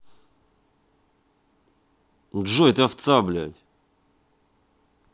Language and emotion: Russian, angry